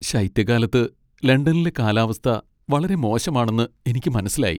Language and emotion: Malayalam, sad